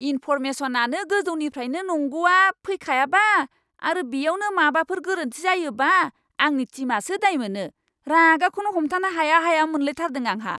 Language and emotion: Bodo, angry